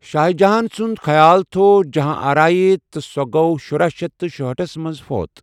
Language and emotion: Kashmiri, neutral